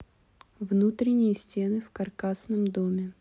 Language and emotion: Russian, neutral